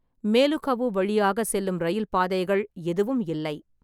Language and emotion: Tamil, neutral